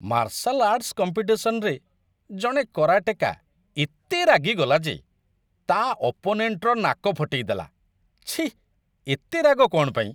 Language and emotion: Odia, disgusted